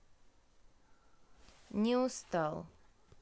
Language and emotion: Russian, neutral